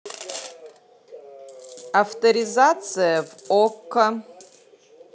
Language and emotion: Russian, neutral